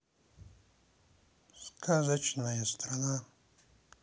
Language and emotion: Russian, neutral